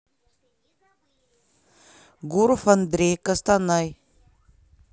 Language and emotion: Russian, neutral